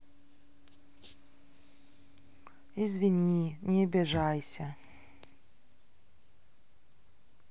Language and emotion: Russian, sad